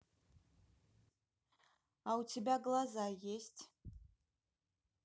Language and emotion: Russian, neutral